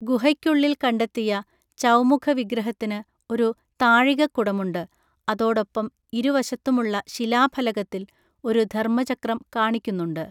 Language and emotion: Malayalam, neutral